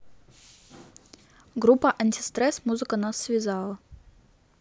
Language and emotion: Russian, neutral